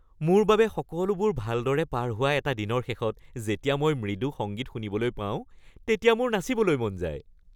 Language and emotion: Assamese, happy